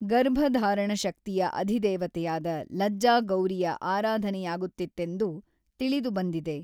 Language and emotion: Kannada, neutral